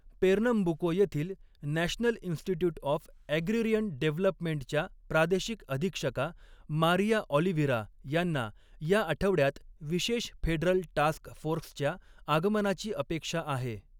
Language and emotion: Marathi, neutral